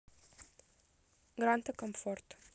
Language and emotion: Russian, neutral